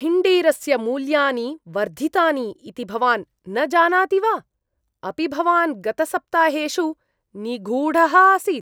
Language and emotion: Sanskrit, disgusted